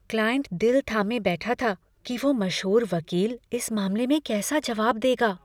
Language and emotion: Hindi, fearful